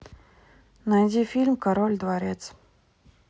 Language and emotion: Russian, neutral